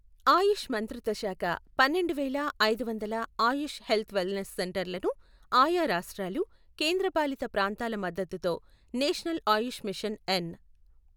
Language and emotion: Telugu, neutral